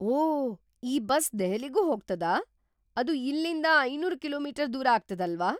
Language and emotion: Kannada, surprised